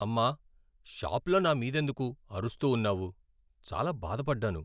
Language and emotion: Telugu, sad